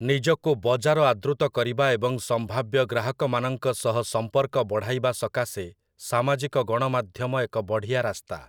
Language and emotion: Odia, neutral